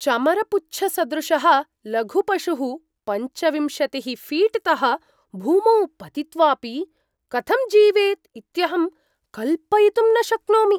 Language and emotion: Sanskrit, surprised